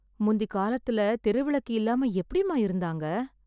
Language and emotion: Tamil, sad